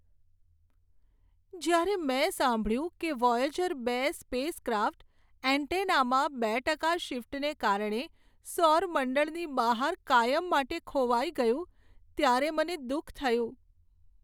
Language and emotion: Gujarati, sad